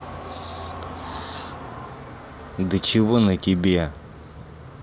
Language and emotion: Russian, angry